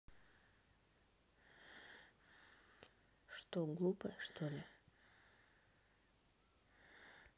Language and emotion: Russian, neutral